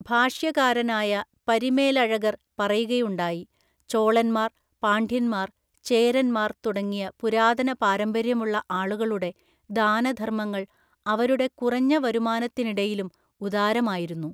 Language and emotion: Malayalam, neutral